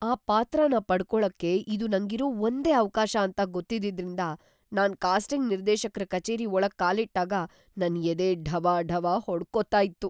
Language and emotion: Kannada, fearful